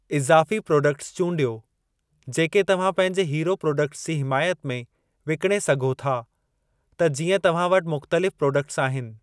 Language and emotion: Sindhi, neutral